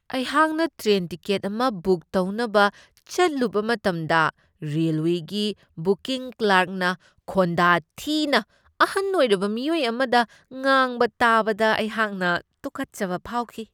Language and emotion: Manipuri, disgusted